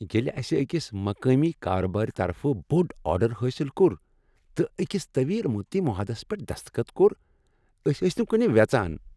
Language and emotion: Kashmiri, happy